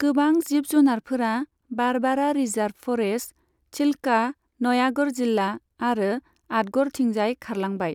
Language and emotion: Bodo, neutral